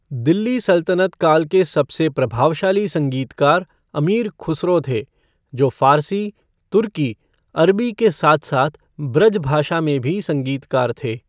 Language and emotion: Hindi, neutral